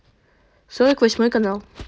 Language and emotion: Russian, neutral